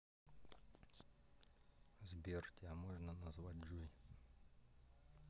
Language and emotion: Russian, neutral